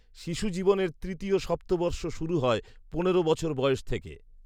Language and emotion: Bengali, neutral